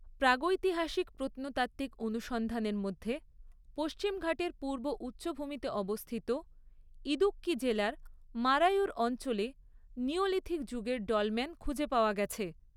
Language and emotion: Bengali, neutral